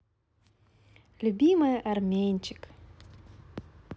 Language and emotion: Russian, positive